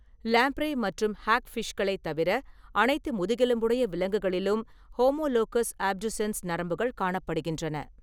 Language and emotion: Tamil, neutral